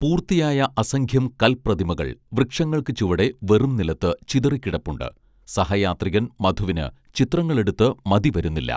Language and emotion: Malayalam, neutral